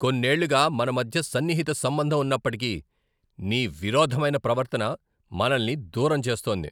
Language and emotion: Telugu, angry